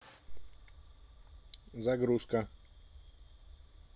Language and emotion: Russian, neutral